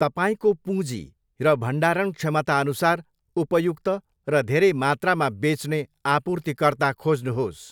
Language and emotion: Nepali, neutral